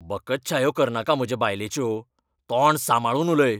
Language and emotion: Goan Konkani, angry